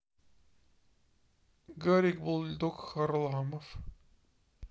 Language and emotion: Russian, neutral